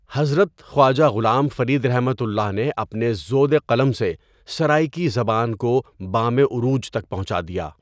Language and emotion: Urdu, neutral